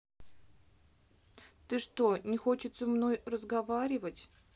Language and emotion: Russian, sad